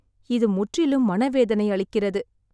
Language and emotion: Tamil, sad